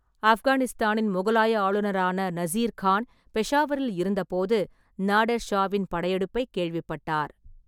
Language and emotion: Tamil, neutral